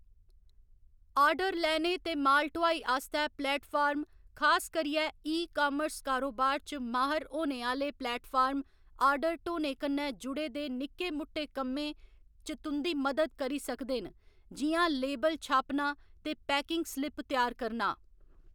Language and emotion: Dogri, neutral